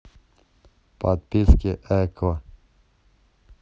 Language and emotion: Russian, neutral